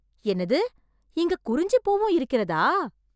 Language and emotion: Tamil, surprised